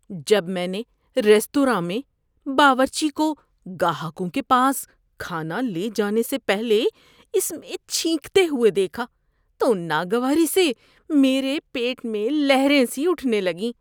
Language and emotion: Urdu, disgusted